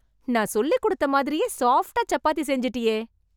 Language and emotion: Tamil, surprised